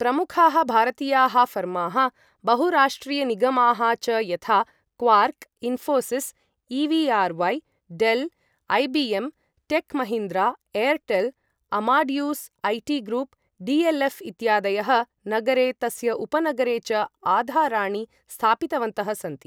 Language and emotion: Sanskrit, neutral